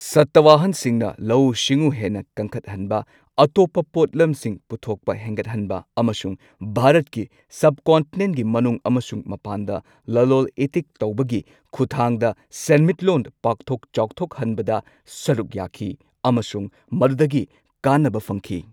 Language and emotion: Manipuri, neutral